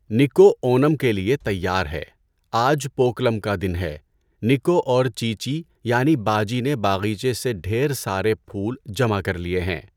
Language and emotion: Urdu, neutral